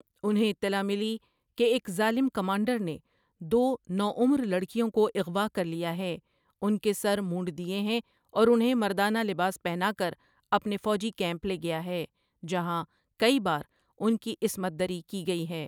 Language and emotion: Urdu, neutral